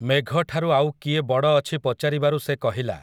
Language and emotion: Odia, neutral